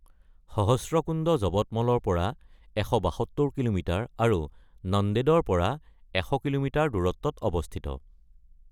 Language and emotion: Assamese, neutral